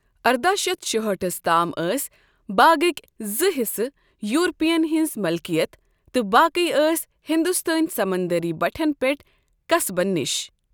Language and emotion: Kashmiri, neutral